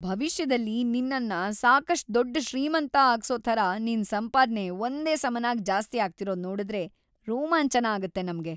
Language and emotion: Kannada, happy